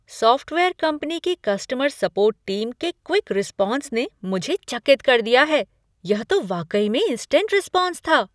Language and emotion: Hindi, surprised